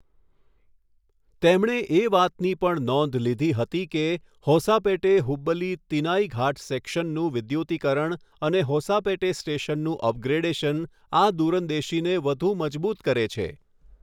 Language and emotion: Gujarati, neutral